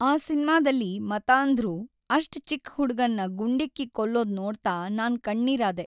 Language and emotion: Kannada, sad